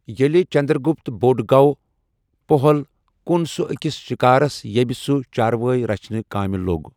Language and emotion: Kashmiri, neutral